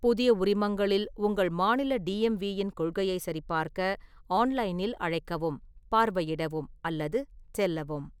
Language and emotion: Tamil, neutral